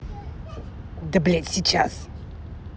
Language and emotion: Russian, angry